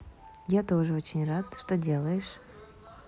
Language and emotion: Russian, neutral